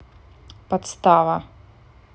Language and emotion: Russian, neutral